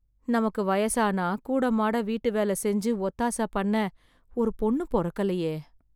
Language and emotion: Tamil, sad